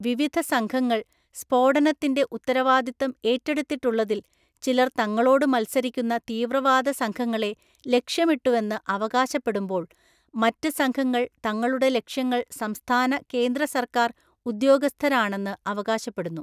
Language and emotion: Malayalam, neutral